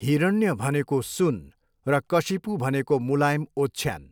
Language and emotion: Nepali, neutral